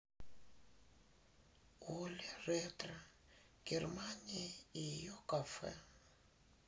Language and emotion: Russian, sad